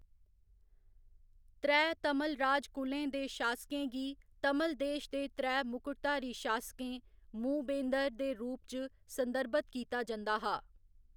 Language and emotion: Dogri, neutral